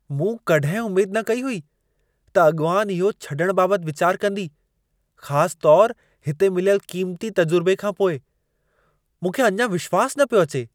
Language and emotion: Sindhi, surprised